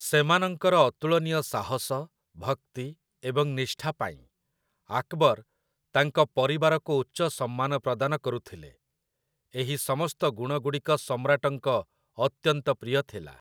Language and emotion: Odia, neutral